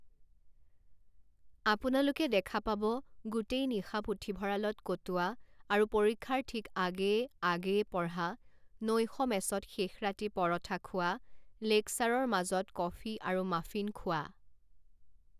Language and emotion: Assamese, neutral